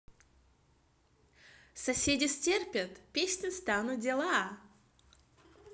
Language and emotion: Russian, positive